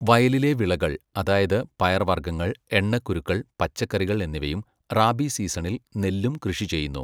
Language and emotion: Malayalam, neutral